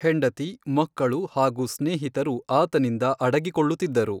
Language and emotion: Kannada, neutral